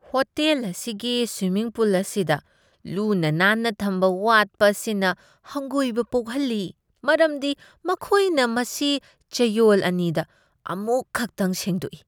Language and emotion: Manipuri, disgusted